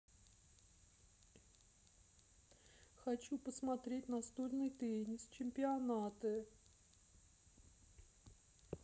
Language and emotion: Russian, sad